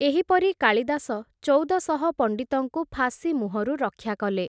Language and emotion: Odia, neutral